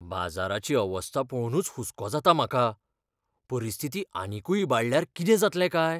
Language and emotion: Goan Konkani, fearful